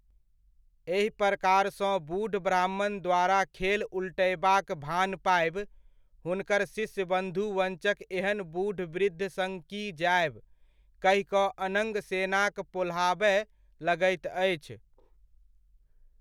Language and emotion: Maithili, neutral